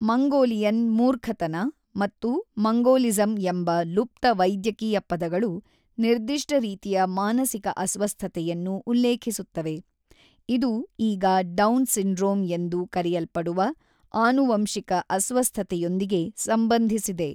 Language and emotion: Kannada, neutral